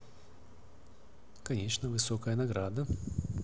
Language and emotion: Russian, neutral